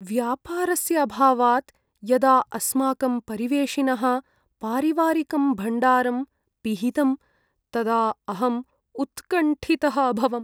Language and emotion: Sanskrit, sad